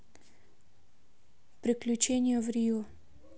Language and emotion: Russian, neutral